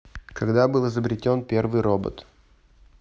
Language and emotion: Russian, neutral